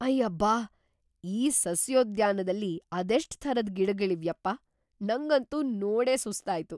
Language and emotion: Kannada, surprised